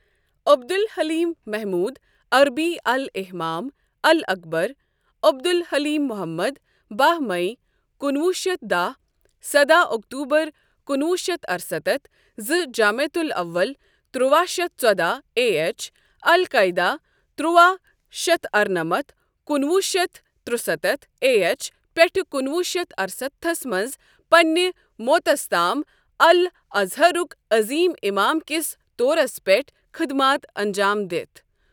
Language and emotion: Kashmiri, neutral